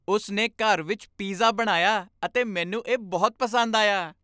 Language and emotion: Punjabi, happy